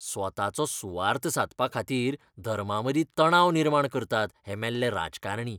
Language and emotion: Goan Konkani, disgusted